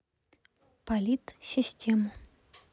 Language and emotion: Russian, neutral